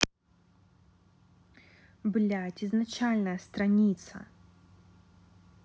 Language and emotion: Russian, angry